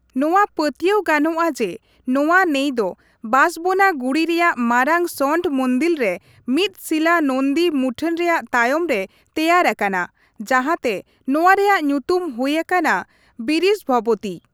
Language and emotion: Santali, neutral